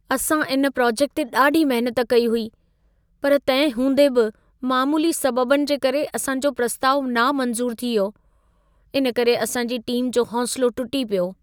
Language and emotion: Sindhi, sad